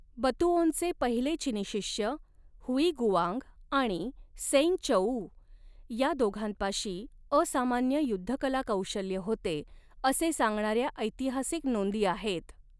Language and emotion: Marathi, neutral